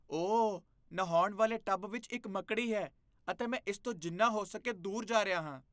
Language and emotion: Punjabi, disgusted